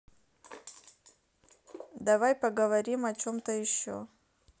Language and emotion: Russian, neutral